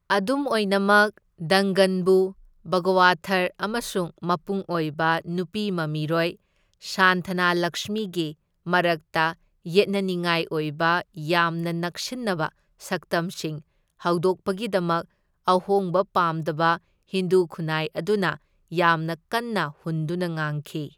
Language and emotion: Manipuri, neutral